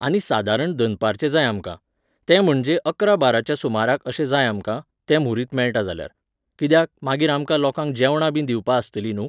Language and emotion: Goan Konkani, neutral